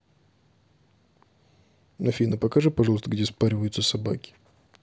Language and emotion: Russian, neutral